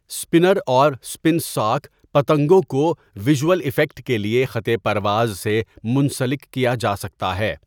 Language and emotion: Urdu, neutral